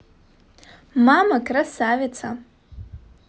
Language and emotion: Russian, positive